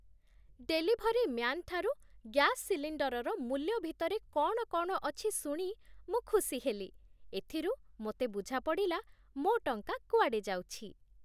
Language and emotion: Odia, happy